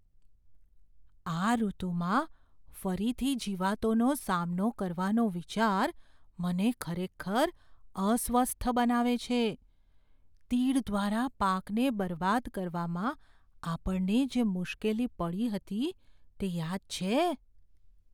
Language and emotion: Gujarati, fearful